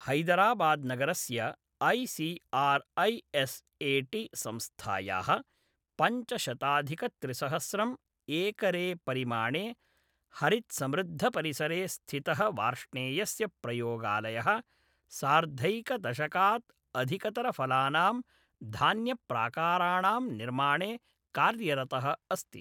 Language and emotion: Sanskrit, neutral